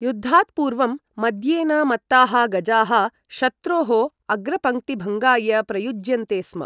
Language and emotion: Sanskrit, neutral